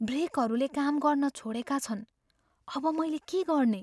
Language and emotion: Nepali, fearful